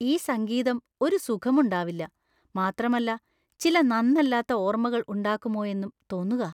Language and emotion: Malayalam, fearful